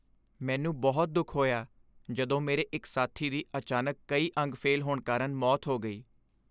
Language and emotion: Punjabi, sad